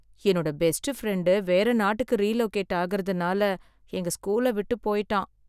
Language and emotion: Tamil, sad